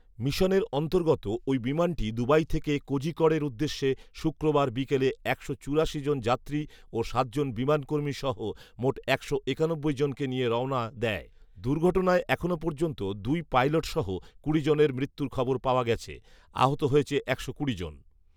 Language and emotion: Bengali, neutral